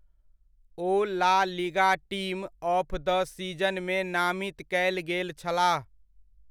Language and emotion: Maithili, neutral